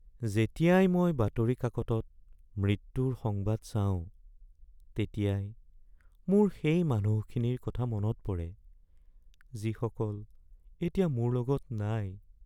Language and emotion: Assamese, sad